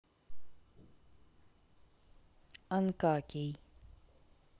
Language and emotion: Russian, neutral